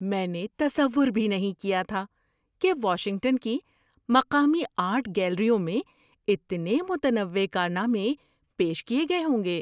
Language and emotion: Urdu, surprised